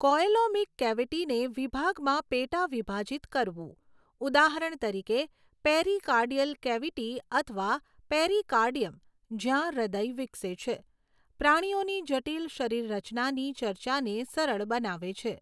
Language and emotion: Gujarati, neutral